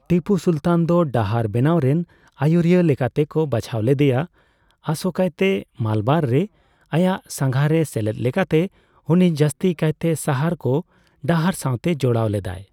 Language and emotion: Santali, neutral